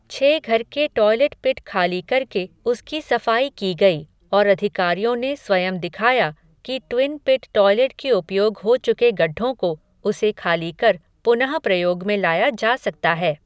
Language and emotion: Hindi, neutral